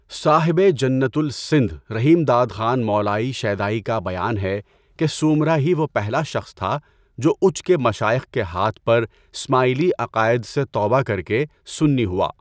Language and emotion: Urdu, neutral